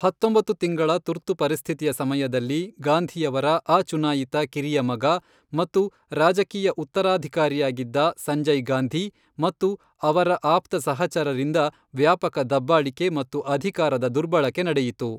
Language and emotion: Kannada, neutral